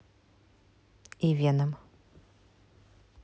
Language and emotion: Russian, neutral